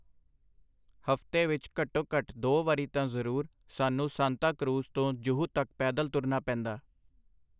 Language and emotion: Punjabi, neutral